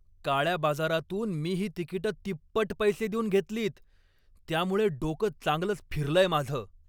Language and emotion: Marathi, angry